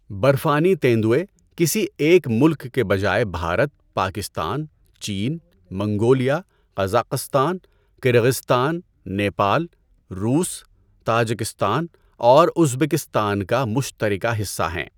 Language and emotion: Urdu, neutral